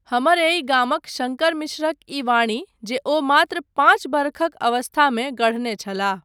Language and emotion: Maithili, neutral